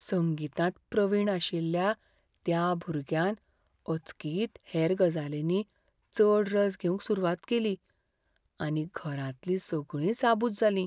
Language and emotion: Goan Konkani, fearful